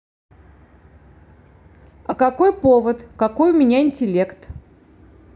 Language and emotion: Russian, neutral